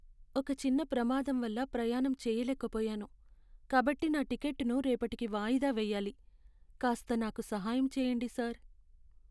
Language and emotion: Telugu, sad